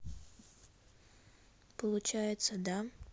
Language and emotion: Russian, neutral